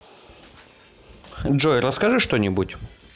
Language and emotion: Russian, neutral